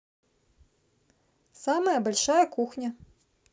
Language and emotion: Russian, neutral